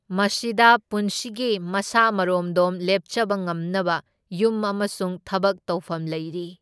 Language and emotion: Manipuri, neutral